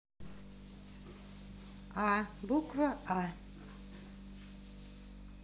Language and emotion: Russian, neutral